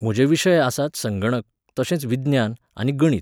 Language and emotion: Goan Konkani, neutral